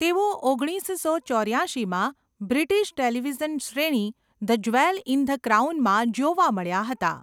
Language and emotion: Gujarati, neutral